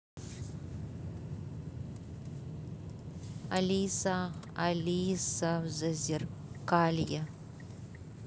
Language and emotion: Russian, neutral